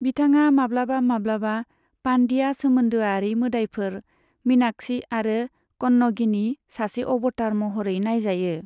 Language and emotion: Bodo, neutral